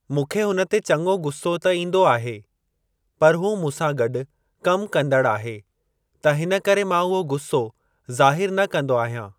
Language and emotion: Sindhi, neutral